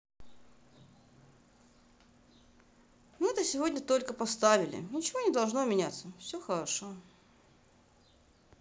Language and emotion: Russian, sad